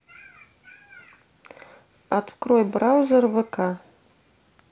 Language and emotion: Russian, neutral